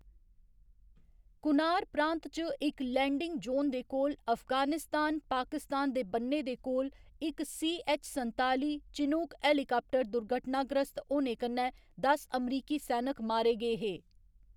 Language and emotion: Dogri, neutral